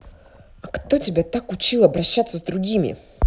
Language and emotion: Russian, angry